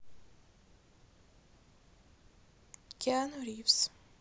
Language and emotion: Russian, neutral